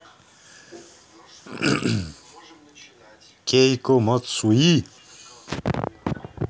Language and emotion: Russian, neutral